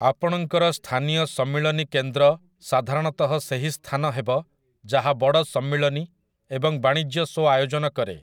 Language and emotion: Odia, neutral